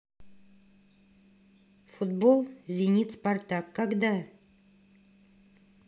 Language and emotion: Russian, neutral